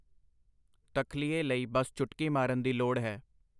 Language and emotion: Punjabi, neutral